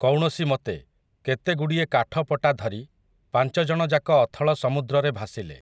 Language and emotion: Odia, neutral